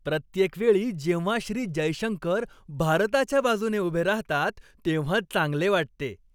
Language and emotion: Marathi, happy